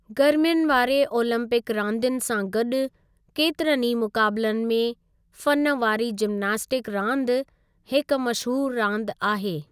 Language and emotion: Sindhi, neutral